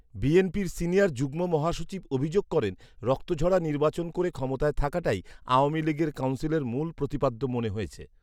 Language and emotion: Bengali, neutral